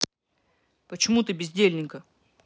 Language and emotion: Russian, angry